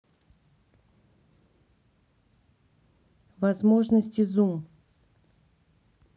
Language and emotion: Russian, neutral